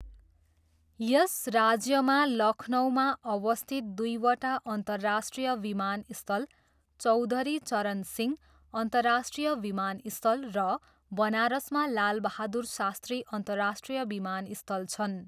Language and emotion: Nepali, neutral